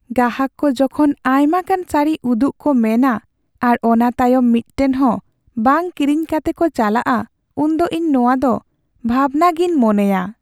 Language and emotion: Santali, sad